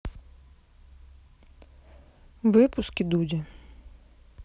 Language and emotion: Russian, neutral